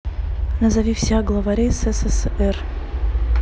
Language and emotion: Russian, neutral